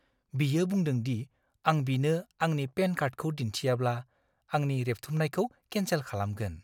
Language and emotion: Bodo, fearful